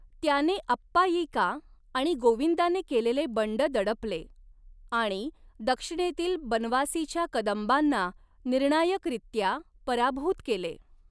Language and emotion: Marathi, neutral